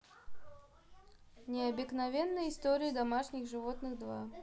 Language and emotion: Russian, neutral